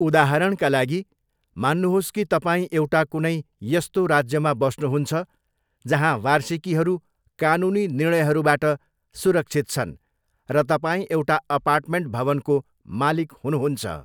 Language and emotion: Nepali, neutral